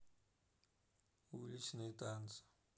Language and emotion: Russian, sad